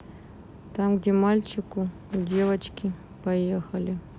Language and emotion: Russian, sad